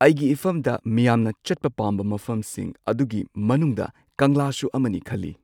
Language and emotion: Manipuri, neutral